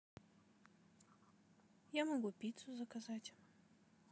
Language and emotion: Russian, neutral